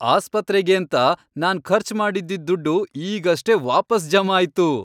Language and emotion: Kannada, happy